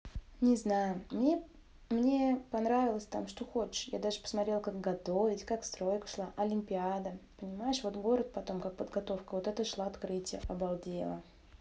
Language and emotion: Russian, positive